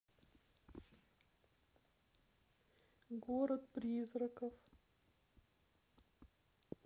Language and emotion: Russian, sad